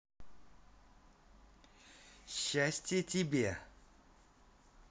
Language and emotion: Russian, positive